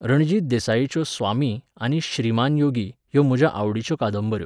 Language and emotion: Goan Konkani, neutral